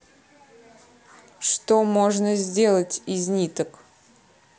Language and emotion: Russian, neutral